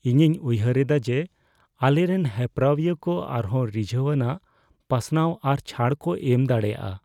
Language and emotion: Santali, fearful